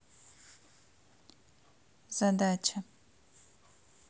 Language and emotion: Russian, neutral